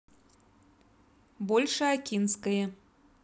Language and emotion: Russian, neutral